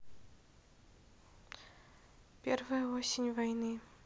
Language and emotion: Russian, neutral